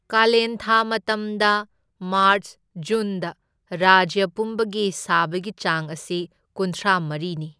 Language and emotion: Manipuri, neutral